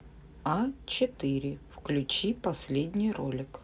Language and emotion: Russian, neutral